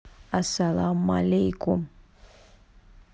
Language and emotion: Russian, neutral